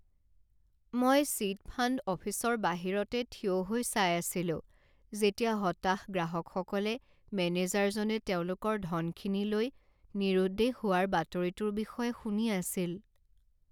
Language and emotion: Assamese, sad